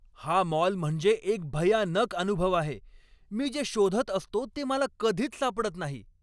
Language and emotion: Marathi, angry